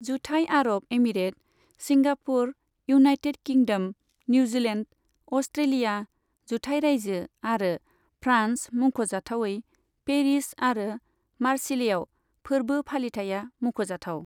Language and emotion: Bodo, neutral